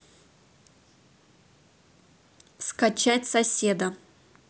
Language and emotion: Russian, neutral